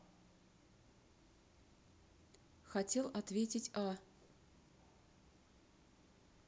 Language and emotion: Russian, neutral